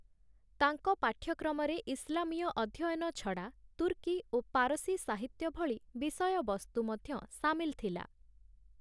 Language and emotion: Odia, neutral